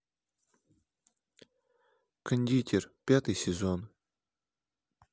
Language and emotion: Russian, neutral